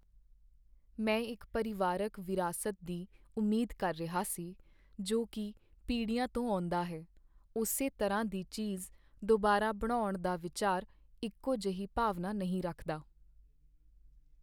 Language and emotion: Punjabi, sad